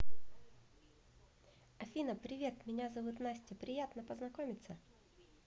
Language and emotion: Russian, positive